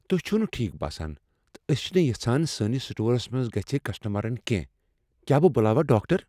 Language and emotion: Kashmiri, fearful